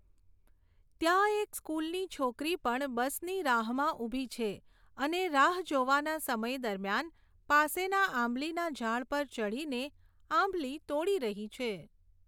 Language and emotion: Gujarati, neutral